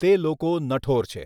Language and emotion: Gujarati, neutral